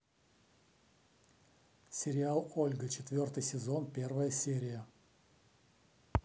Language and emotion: Russian, neutral